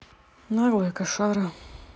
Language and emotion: Russian, neutral